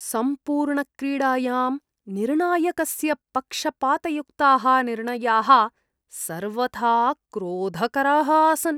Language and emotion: Sanskrit, disgusted